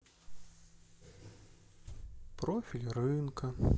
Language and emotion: Russian, sad